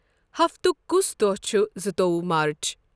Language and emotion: Kashmiri, neutral